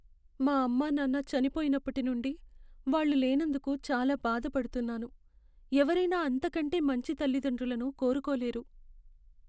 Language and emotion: Telugu, sad